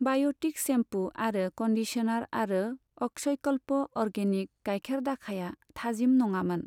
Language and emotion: Bodo, neutral